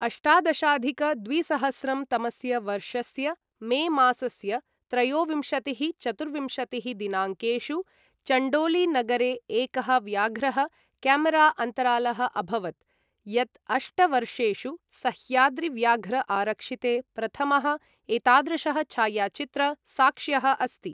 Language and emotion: Sanskrit, neutral